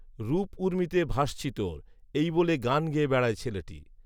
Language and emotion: Bengali, neutral